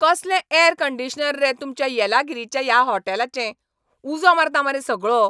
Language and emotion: Goan Konkani, angry